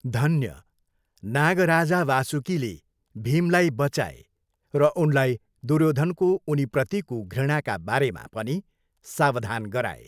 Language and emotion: Nepali, neutral